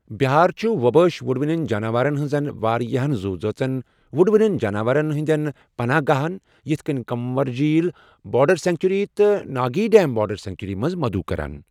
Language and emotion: Kashmiri, neutral